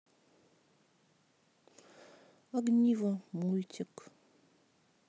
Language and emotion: Russian, sad